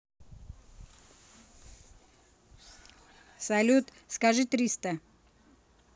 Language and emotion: Russian, neutral